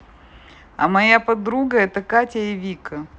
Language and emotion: Russian, neutral